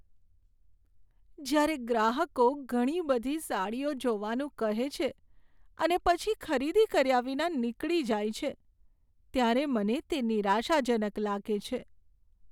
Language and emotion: Gujarati, sad